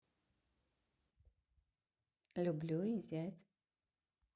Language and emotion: Russian, neutral